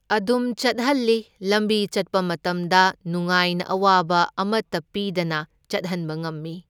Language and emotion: Manipuri, neutral